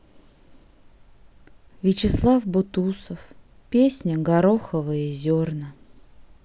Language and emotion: Russian, sad